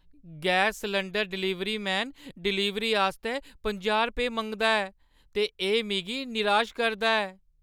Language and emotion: Dogri, sad